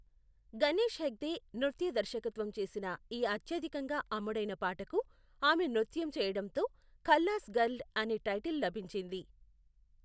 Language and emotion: Telugu, neutral